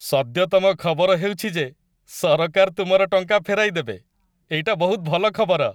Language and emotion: Odia, happy